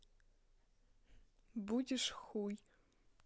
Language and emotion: Russian, neutral